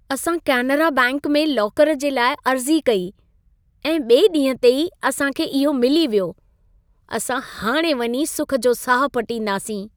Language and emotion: Sindhi, happy